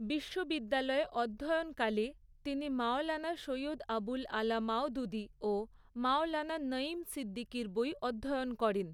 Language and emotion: Bengali, neutral